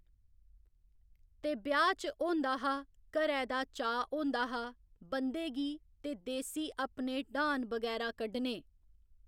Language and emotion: Dogri, neutral